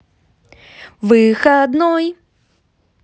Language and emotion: Russian, positive